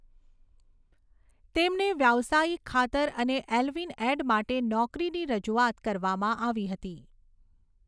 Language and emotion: Gujarati, neutral